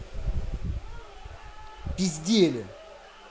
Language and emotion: Russian, angry